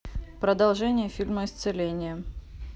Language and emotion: Russian, neutral